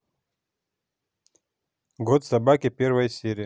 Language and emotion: Russian, neutral